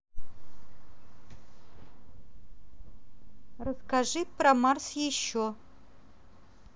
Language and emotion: Russian, neutral